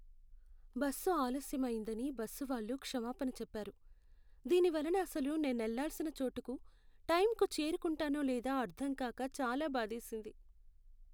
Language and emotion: Telugu, sad